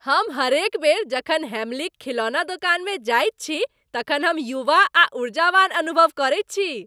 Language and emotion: Maithili, happy